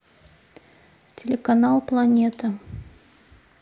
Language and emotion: Russian, neutral